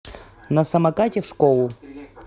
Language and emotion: Russian, neutral